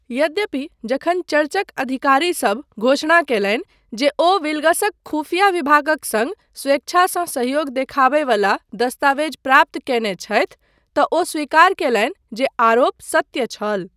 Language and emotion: Maithili, neutral